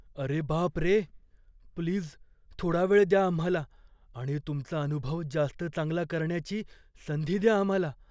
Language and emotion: Marathi, fearful